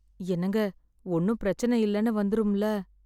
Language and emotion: Tamil, fearful